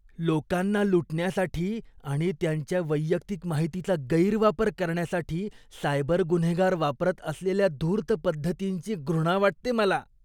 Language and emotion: Marathi, disgusted